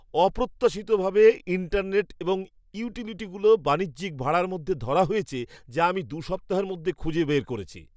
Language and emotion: Bengali, surprised